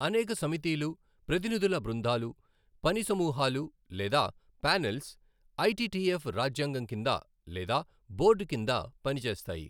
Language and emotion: Telugu, neutral